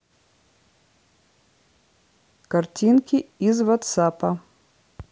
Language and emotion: Russian, neutral